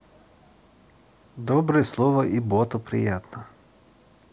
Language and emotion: Russian, positive